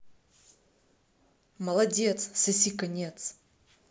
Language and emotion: Russian, angry